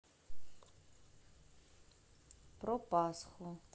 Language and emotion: Russian, neutral